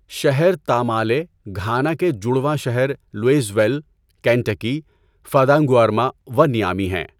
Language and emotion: Urdu, neutral